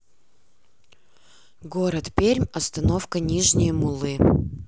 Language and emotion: Russian, neutral